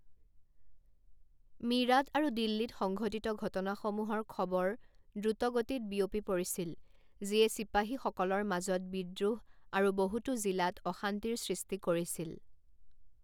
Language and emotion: Assamese, neutral